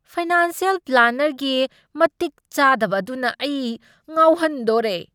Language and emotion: Manipuri, angry